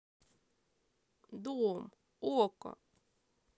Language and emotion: Russian, sad